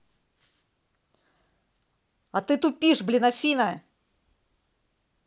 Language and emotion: Russian, angry